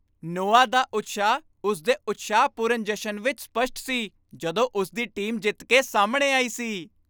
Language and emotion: Punjabi, happy